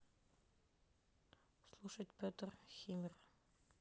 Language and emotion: Russian, neutral